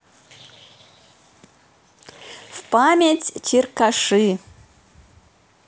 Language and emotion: Russian, positive